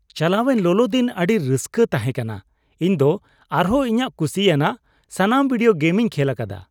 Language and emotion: Santali, happy